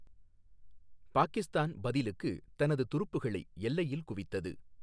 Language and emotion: Tamil, neutral